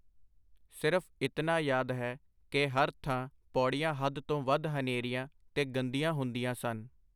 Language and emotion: Punjabi, neutral